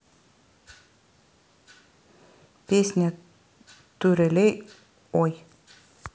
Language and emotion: Russian, neutral